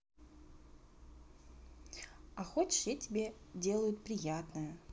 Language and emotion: Russian, positive